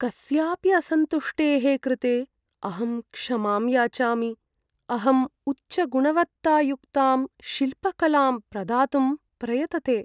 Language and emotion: Sanskrit, sad